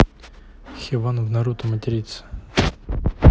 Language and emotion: Russian, neutral